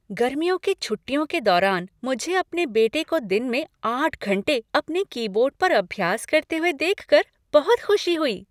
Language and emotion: Hindi, happy